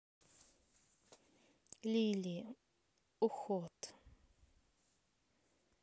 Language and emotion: Russian, neutral